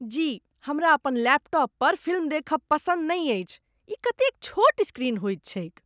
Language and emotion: Maithili, disgusted